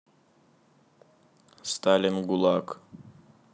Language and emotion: Russian, neutral